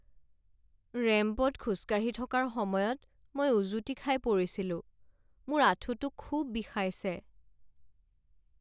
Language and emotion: Assamese, sad